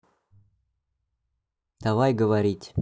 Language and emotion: Russian, neutral